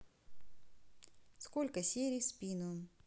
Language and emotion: Russian, neutral